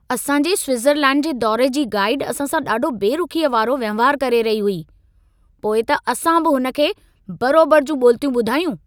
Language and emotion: Sindhi, angry